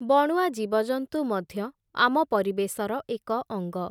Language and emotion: Odia, neutral